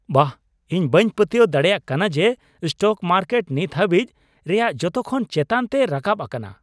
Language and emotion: Santali, surprised